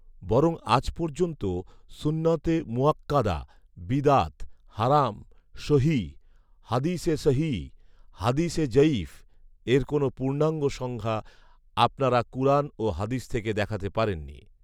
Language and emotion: Bengali, neutral